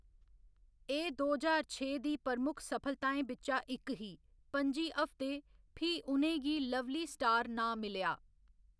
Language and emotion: Dogri, neutral